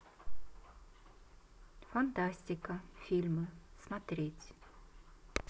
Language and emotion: Russian, neutral